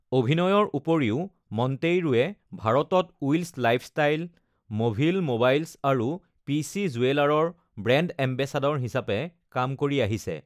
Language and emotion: Assamese, neutral